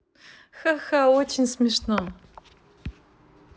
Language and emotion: Russian, positive